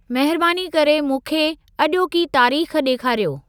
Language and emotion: Sindhi, neutral